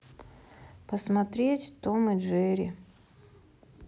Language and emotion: Russian, sad